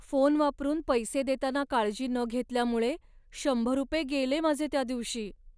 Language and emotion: Marathi, sad